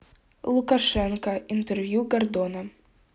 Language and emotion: Russian, neutral